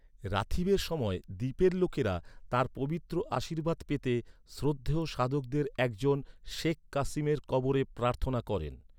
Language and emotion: Bengali, neutral